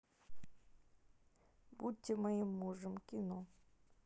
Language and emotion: Russian, neutral